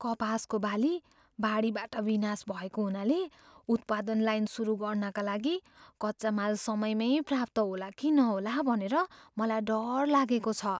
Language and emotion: Nepali, fearful